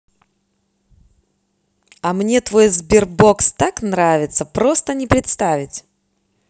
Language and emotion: Russian, positive